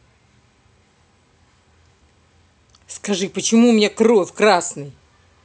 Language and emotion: Russian, angry